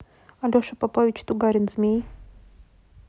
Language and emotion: Russian, neutral